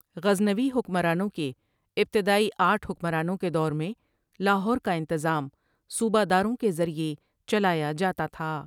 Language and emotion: Urdu, neutral